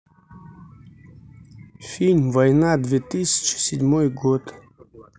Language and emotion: Russian, neutral